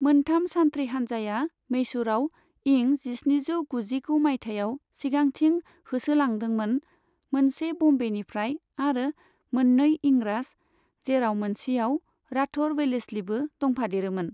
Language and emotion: Bodo, neutral